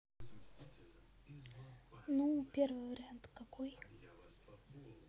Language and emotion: Russian, neutral